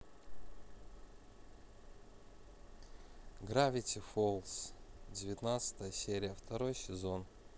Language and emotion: Russian, neutral